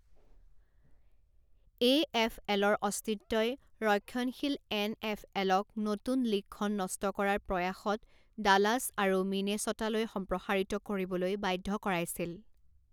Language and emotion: Assamese, neutral